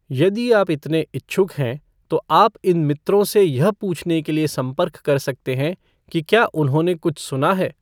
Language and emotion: Hindi, neutral